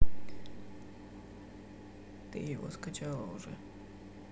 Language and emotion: Russian, neutral